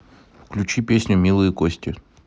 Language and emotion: Russian, neutral